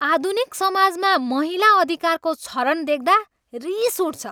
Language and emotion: Nepali, angry